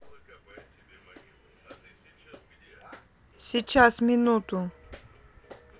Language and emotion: Russian, neutral